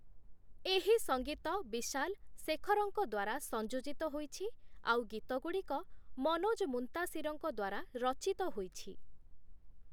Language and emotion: Odia, neutral